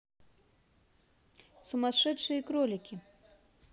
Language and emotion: Russian, neutral